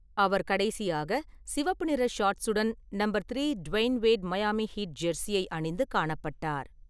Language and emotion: Tamil, neutral